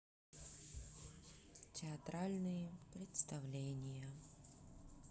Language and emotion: Russian, neutral